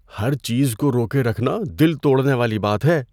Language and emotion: Urdu, fearful